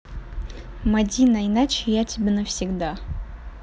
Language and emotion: Russian, neutral